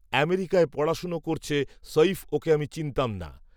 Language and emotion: Bengali, neutral